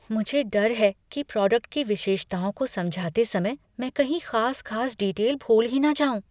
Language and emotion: Hindi, fearful